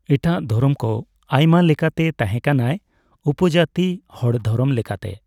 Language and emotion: Santali, neutral